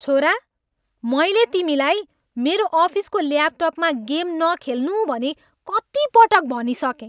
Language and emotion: Nepali, angry